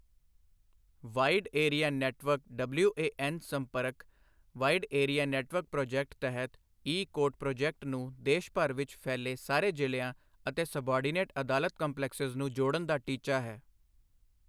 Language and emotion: Punjabi, neutral